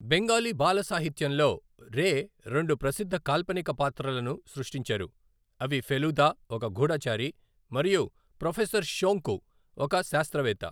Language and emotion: Telugu, neutral